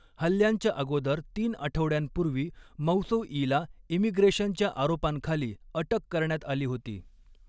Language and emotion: Marathi, neutral